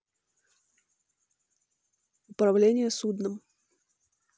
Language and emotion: Russian, neutral